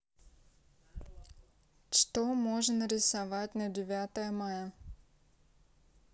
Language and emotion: Russian, neutral